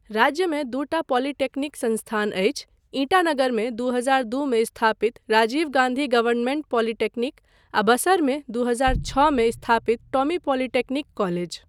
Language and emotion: Maithili, neutral